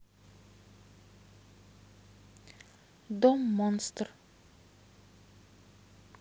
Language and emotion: Russian, neutral